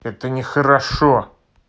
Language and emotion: Russian, angry